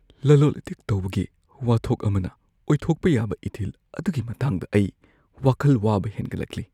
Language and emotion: Manipuri, fearful